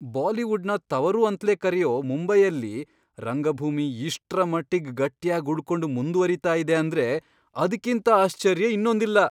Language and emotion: Kannada, surprised